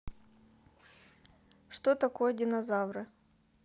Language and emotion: Russian, neutral